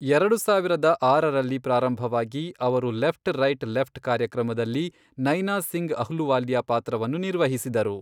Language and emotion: Kannada, neutral